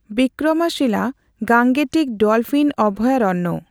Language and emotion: Santali, neutral